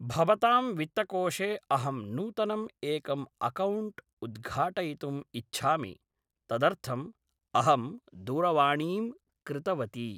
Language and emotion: Sanskrit, neutral